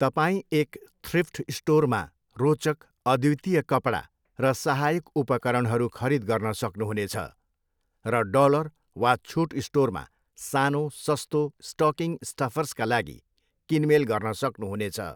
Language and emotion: Nepali, neutral